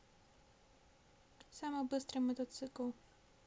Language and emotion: Russian, neutral